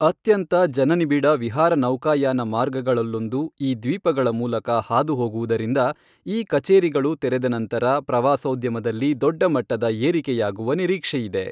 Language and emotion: Kannada, neutral